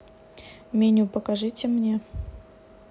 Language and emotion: Russian, neutral